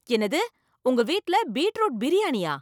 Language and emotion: Tamil, surprised